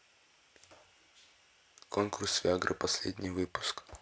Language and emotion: Russian, neutral